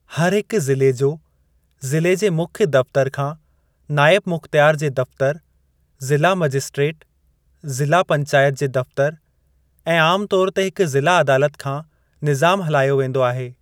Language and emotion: Sindhi, neutral